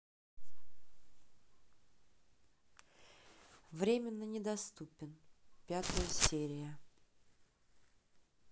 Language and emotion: Russian, neutral